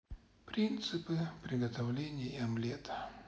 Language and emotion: Russian, sad